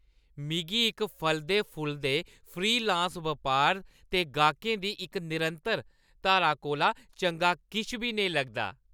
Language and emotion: Dogri, happy